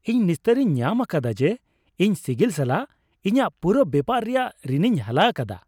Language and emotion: Santali, happy